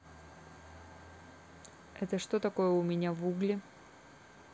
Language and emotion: Russian, neutral